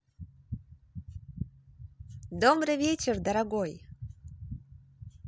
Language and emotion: Russian, positive